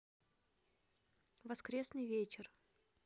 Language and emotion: Russian, neutral